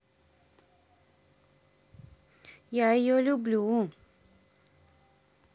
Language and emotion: Russian, positive